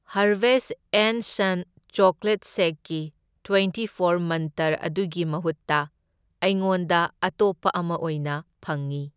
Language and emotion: Manipuri, neutral